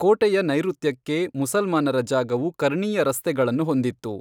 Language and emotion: Kannada, neutral